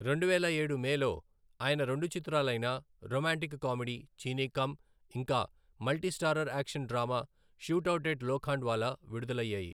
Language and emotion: Telugu, neutral